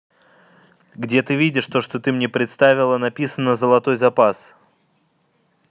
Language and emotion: Russian, angry